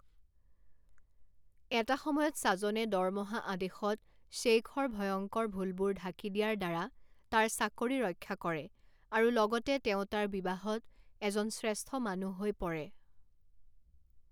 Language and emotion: Assamese, neutral